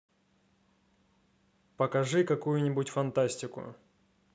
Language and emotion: Russian, neutral